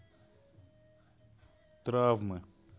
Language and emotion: Russian, sad